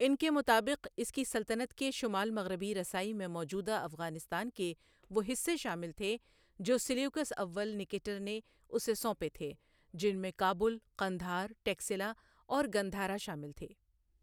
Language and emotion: Urdu, neutral